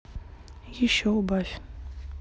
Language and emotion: Russian, neutral